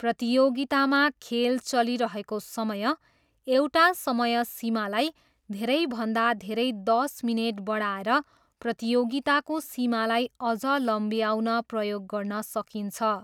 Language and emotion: Nepali, neutral